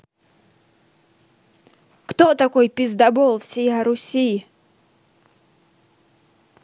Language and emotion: Russian, angry